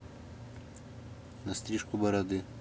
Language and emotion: Russian, neutral